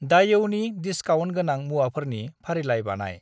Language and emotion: Bodo, neutral